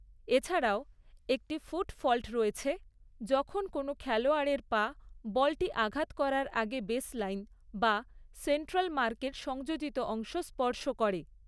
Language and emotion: Bengali, neutral